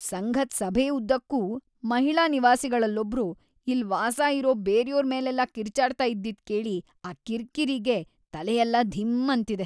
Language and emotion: Kannada, disgusted